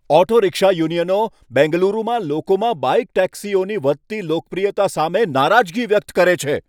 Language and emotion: Gujarati, angry